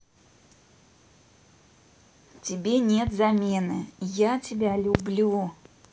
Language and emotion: Russian, neutral